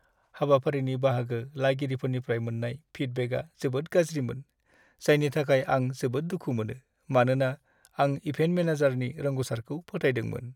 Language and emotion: Bodo, sad